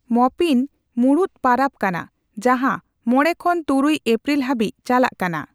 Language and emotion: Santali, neutral